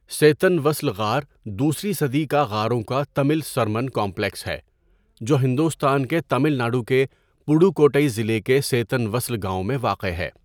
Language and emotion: Urdu, neutral